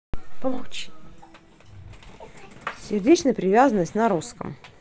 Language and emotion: Russian, neutral